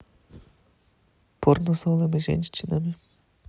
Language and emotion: Russian, neutral